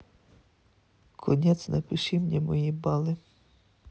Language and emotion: Russian, neutral